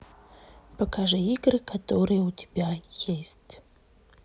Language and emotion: Russian, neutral